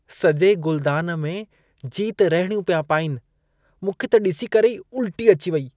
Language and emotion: Sindhi, disgusted